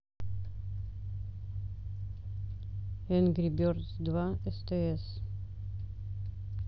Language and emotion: Russian, neutral